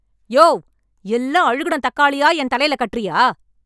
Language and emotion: Tamil, angry